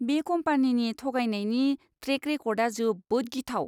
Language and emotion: Bodo, disgusted